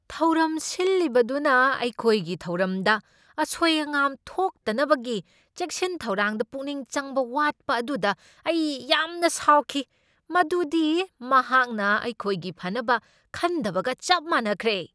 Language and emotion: Manipuri, angry